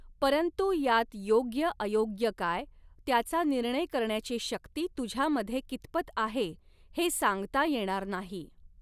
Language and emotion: Marathi, neutral